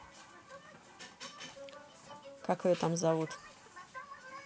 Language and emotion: Russian, neutral